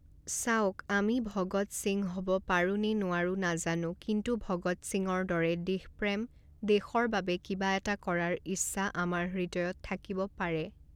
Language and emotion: Assamese, neutral